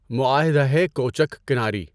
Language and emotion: Urdu, neutral